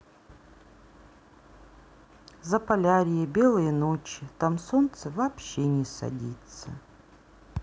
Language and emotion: Russian, neutral